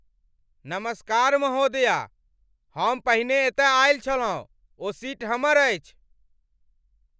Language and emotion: Maithili, angry